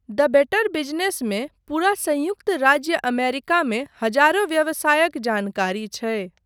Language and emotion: Maithili, neutral